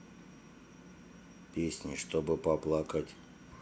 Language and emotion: Russian, neutral